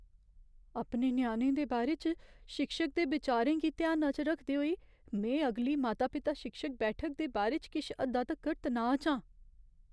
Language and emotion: Dogri, fearful